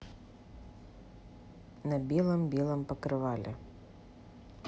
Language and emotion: Russian, neutral